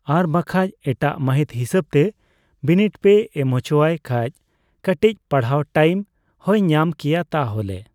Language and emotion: Santali, neutral